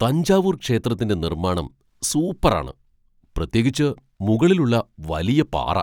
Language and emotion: Malayalam, surprised